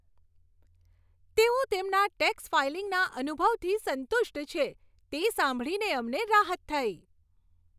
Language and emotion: Gujarati, happy